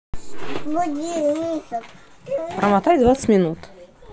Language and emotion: Russian, neutral